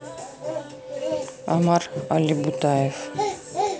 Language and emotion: Russian, neutral